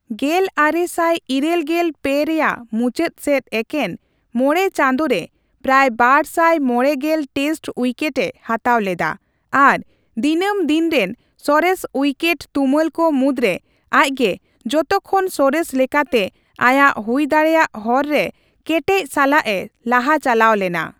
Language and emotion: Santali, neutral